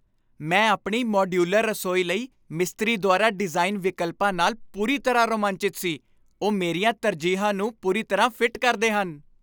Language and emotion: Punjabi, happy